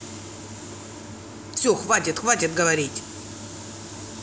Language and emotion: Russian, angry